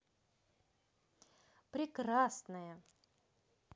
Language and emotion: Russian, positive